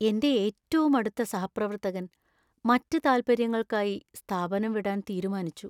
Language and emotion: Malayalam, sad